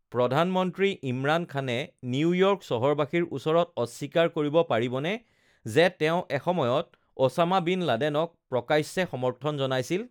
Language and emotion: Assamese, neutral